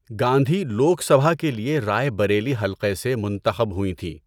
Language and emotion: Urdu, neutral